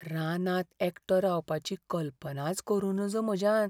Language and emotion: Goan Konkani, fearful